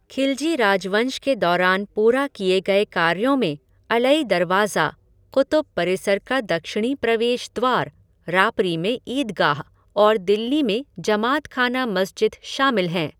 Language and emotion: Hindi, neutral